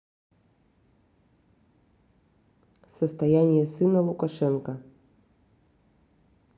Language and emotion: Russian, neutral